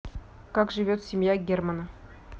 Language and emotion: Russian, neutral